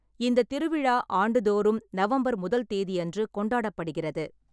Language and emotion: Tamil, neutral